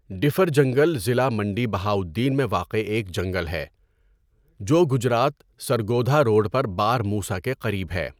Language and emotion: Urdu, neutral